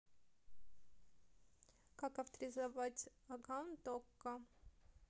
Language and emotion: Russian, neutral